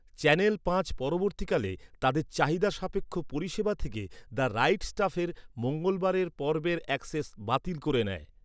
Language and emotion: Bengali, neutral